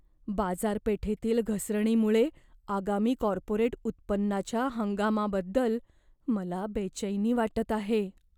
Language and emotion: Marathi, fearful